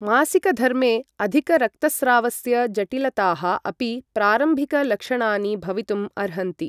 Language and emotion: Sanskrit, neutral